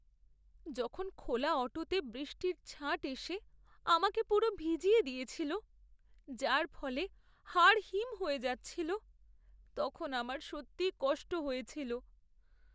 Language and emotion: Bengali, sad